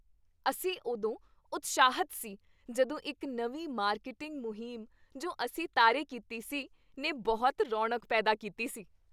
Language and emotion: Punjabi, happy